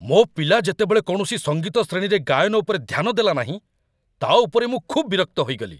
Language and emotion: Odia, angry